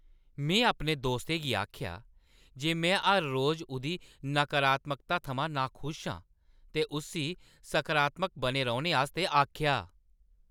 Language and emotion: Dogri, angry